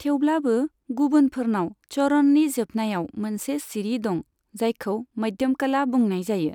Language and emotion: Bodo, neutral